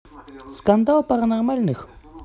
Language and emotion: Russian, neutral